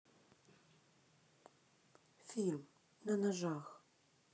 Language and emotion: Russian, neutral